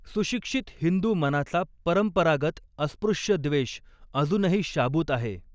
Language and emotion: Marathi, neutral